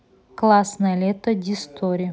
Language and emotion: Russian, neutral